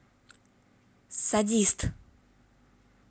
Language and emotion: Russian, angry